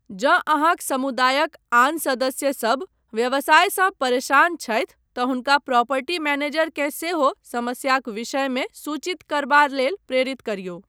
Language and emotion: Maithili, neutral